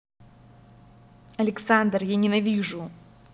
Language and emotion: Russian, angry